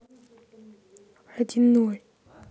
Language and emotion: Russian, neutral